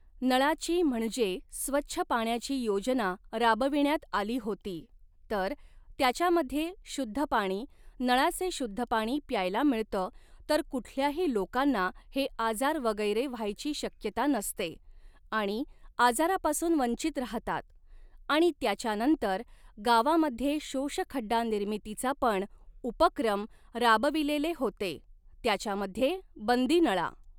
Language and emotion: Marathi, neutral